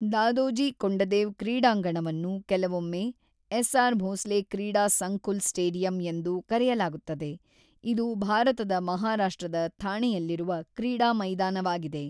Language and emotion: Kannada, neutral